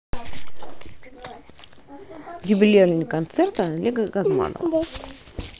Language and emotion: Russian, neutral